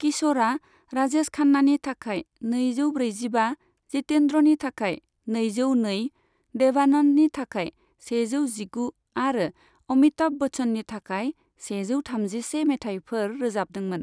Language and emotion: Bodo, neutral